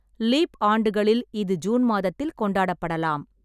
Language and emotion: Tamil, neutral